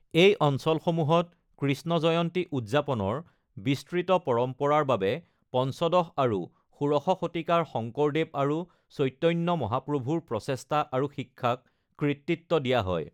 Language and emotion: Assamese, neutral